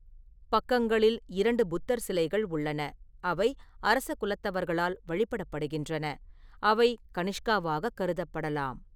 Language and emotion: Tamil, neutral